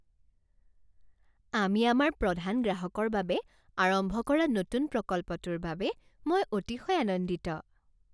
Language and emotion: Assamese, happy